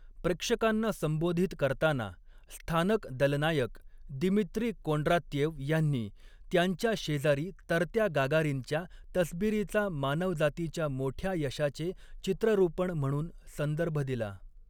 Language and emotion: Marathi, neutral